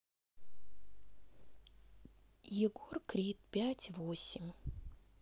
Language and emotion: Russian, neutral